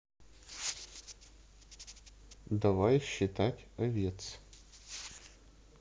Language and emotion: Russian, neutral